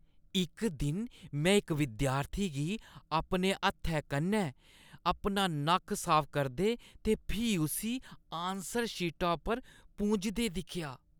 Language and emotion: Dogri, disgusted